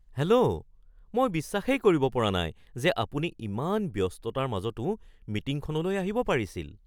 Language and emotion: Assamese, surprised